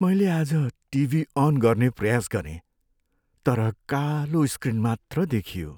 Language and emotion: Nepali, sad